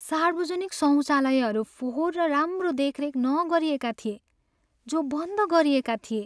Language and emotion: Nepali, sad